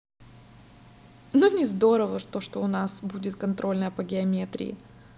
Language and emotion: Russian, neutral